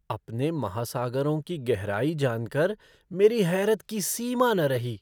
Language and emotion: Hindi, surprised